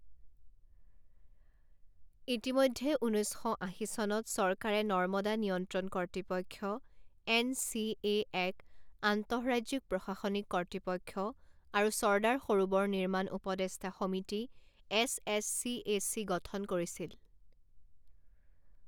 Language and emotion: Assamese, neutral